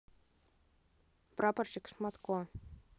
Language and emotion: Russian, neutral